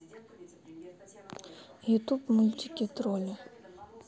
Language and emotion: Russian, sad